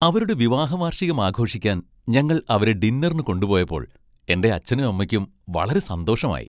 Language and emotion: Malayalam, happy